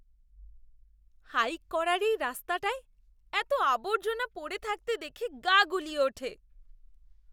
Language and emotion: Bengali, disgusted